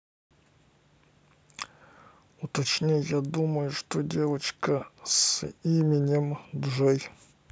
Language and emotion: Russian, neutral